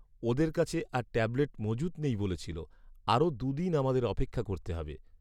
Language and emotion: Bengali, sad